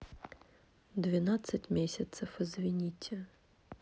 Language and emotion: Russian, sad